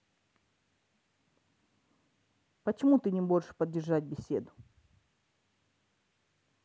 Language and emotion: Russian, angry